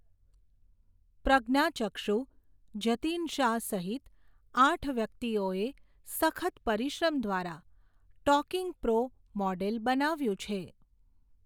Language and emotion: Gujarati, neutral